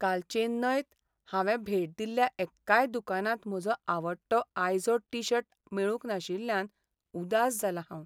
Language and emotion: Goan Konkani, sad